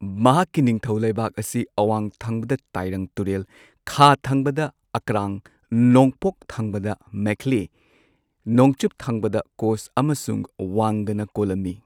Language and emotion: Manipuri, neutral